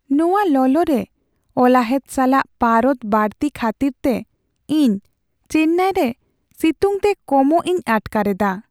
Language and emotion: Santali, sad